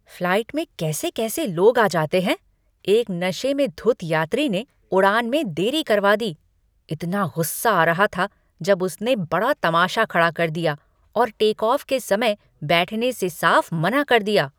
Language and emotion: Hindi, angry